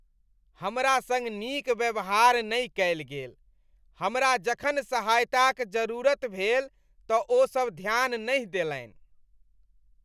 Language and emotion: Maithili, disgusted